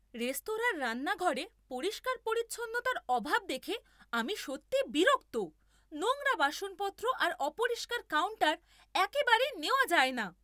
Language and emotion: Bengali, angry